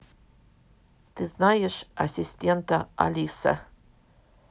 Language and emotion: Russian, neutral